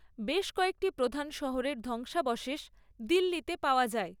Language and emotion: Bengali, neutral